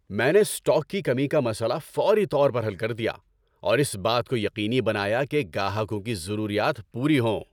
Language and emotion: Urdu, happy